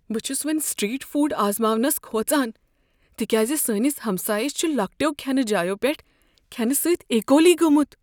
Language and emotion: Kashmiri, fearful